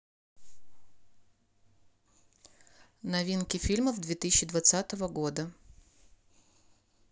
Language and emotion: Russian, neutral